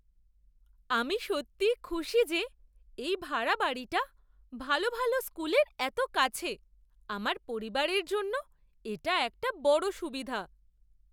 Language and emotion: Bengali, surprised